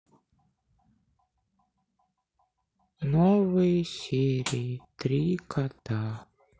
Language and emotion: Russian, sad